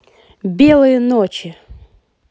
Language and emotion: Russian, positive